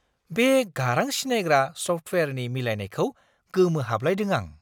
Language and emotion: Bodo, surprised